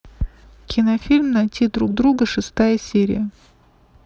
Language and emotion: Russian, neutral